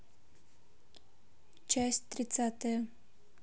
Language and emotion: Russian, neutral